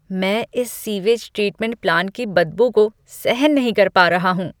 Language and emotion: Hindi, disgusted